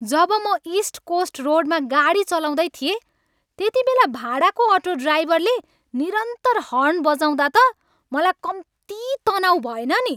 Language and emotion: Nepali, angry